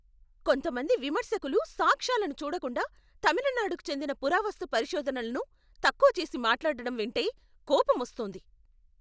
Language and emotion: Telugu, angry